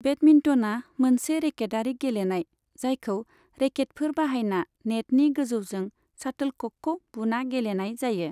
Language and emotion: Bodo, neutral